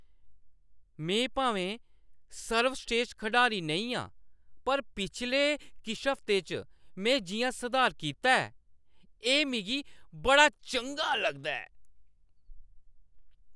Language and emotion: Dogri, happy